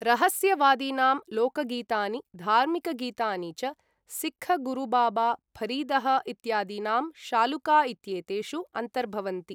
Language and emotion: Sanskrit, neutral